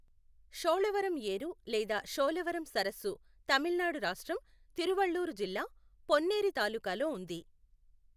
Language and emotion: Telugu, neutral